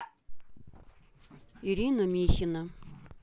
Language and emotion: Russian, neutral